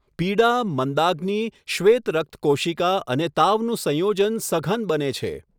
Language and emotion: Gujarati, neutral